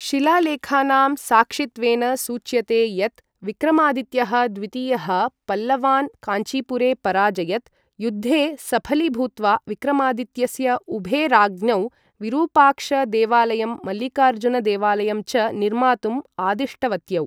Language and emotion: Sanskrit, neutral